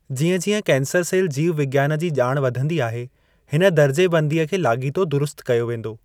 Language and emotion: Sindhi, neutral